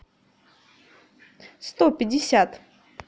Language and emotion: Russian, positive